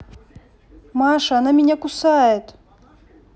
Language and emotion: Russian, neutral